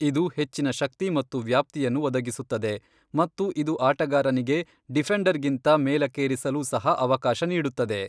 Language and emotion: Kannada, neutral